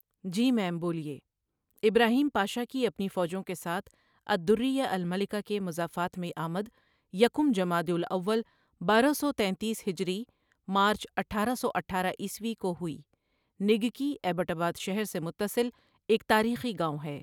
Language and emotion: Urdu, neutral